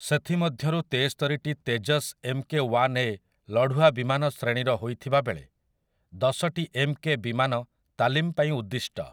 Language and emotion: Odia, neutral